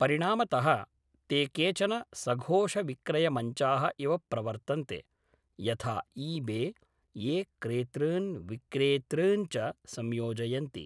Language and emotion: Sanskrit, neutral